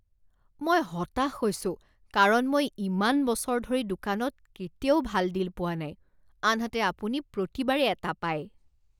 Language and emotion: Assamese, disgusted